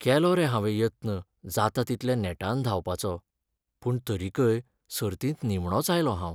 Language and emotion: Goan Konkani, sad